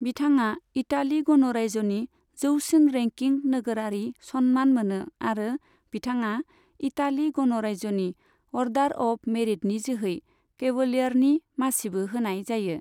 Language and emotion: Bodo, neutral